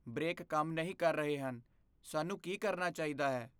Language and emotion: Punjabi, fearful